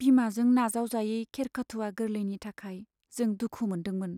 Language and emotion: Bodo, sad